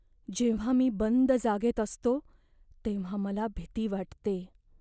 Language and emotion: Marathi, fearful